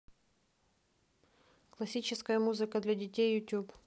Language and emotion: Russian, neutral